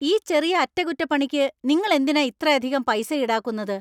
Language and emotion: Malayalam, angry